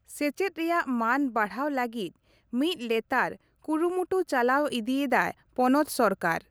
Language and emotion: Santali, neutral